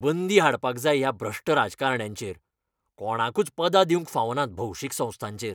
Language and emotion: Goan Konkani, angry